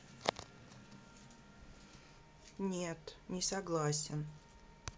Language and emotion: Russian, sad